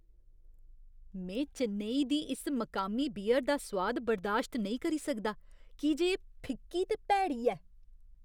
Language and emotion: Dogri, disgusted